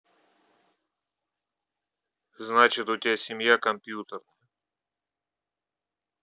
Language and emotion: Russian, neutral